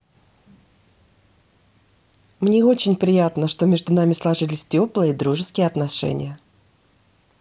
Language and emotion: Russian, positive